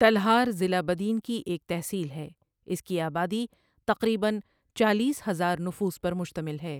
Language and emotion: Urdu, neutral